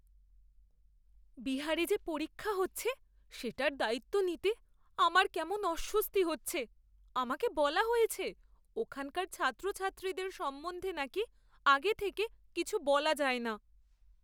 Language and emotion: Bengali, fearful